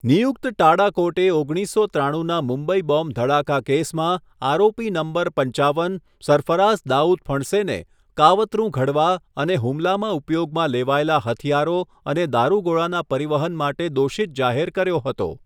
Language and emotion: Gujarati, neutral